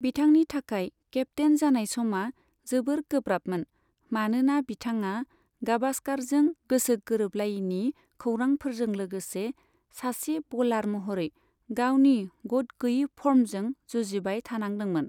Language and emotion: Bodo, neutral